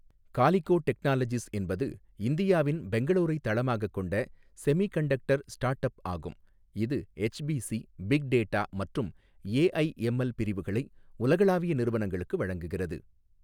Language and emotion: Tamil, neutral